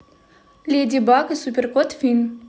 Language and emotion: Russian, neutral